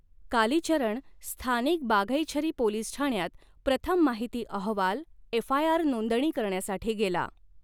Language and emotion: Marathi, neutral